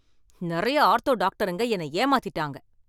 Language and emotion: Tamil, angry